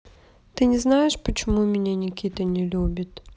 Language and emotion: Russian, sad